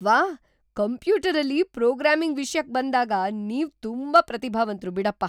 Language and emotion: Kannada, surprised